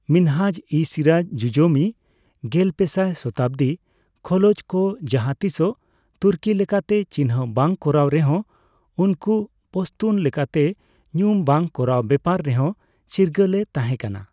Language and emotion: Santali, neutral